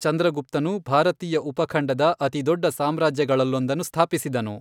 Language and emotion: Kannada, neutral